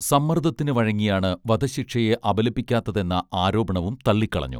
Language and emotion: Malayalam, neutral